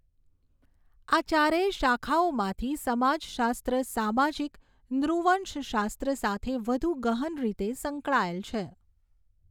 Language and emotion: Gujarati, neutral